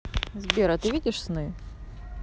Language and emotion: Russian, neutral